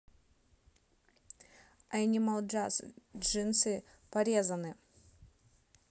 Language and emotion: Russian, neutral